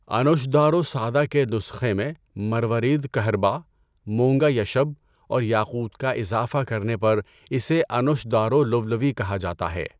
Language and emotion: Urdu, neutral